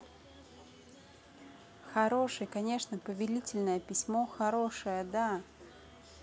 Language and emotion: Russian, positive